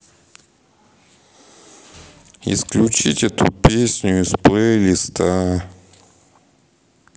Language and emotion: Russian, sad